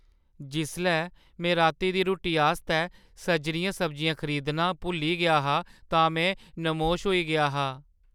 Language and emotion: Dogri, sad